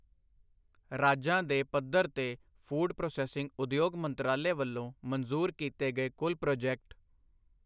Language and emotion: Punjabi, neutral